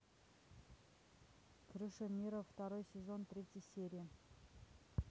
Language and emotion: Russian, neutral